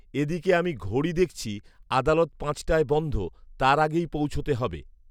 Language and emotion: Bengali, neutral